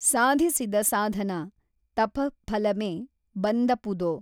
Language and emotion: Kannada, neutral